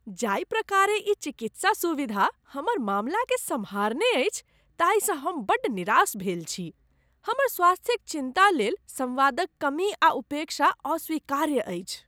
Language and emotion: Maithili, disgusted